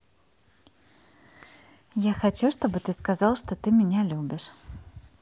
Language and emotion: Russian, positive